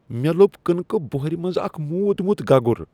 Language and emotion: Kashmiri, disgusted